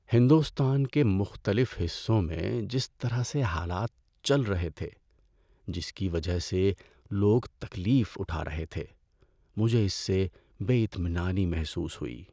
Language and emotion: Urdu, sad